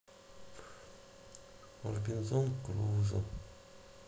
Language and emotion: Russian, sad